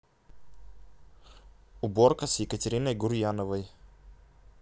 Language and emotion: Russian, neutral